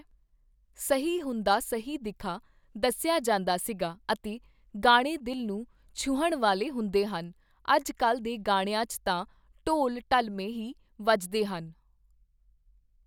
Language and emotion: Punjabi, neutral